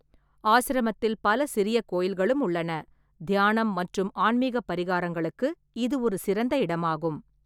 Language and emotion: Tamil, neutral